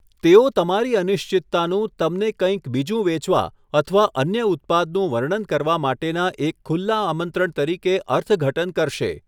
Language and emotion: Gujarati, neutral